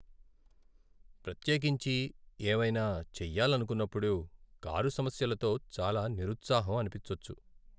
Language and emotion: Telugu, sad